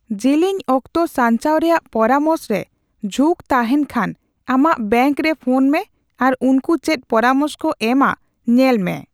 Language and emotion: Santali, neutral